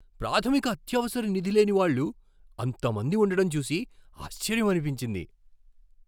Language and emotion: Telugu, surprised